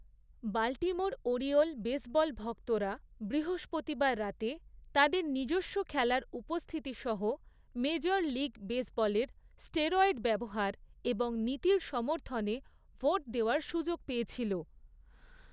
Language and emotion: Bengali, neutral